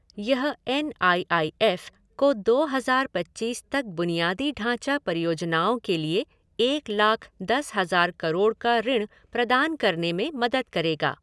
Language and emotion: Hindi, neutral